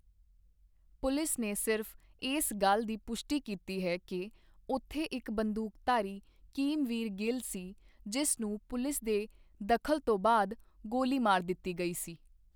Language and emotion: Punjabi, neutral